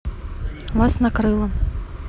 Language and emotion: Russian, neutral